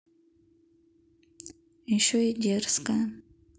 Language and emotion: Russian, neutral